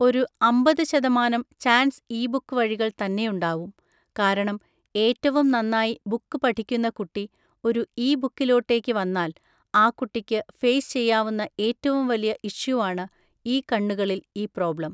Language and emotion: Malayalam, neutral